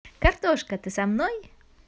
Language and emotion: Russian, positive